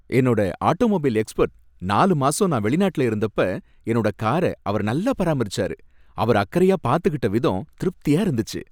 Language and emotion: Tamil, happy